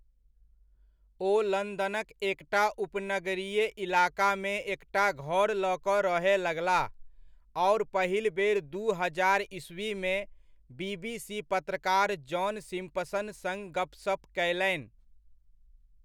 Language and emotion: Maithili, neutral